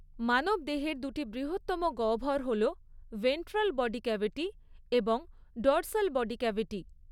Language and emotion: Bengali, neutral